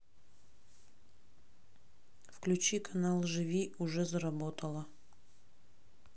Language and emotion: Russian, neutral